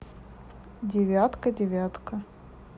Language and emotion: Russian, neutral